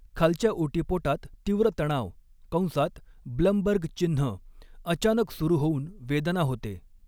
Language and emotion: Marathi, neutral